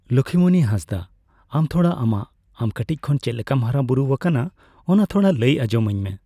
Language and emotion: Santali, neutral